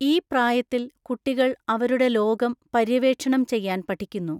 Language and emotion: Malayalam, neutral